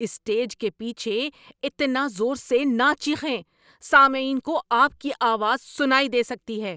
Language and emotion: Urdu, angry